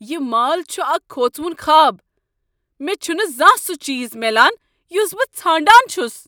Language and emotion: Kashmiri, angry